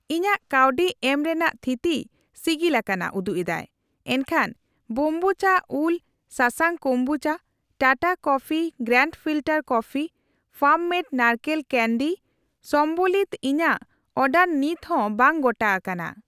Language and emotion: Santali, neutral